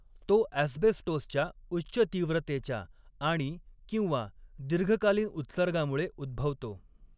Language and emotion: Marathi, neutral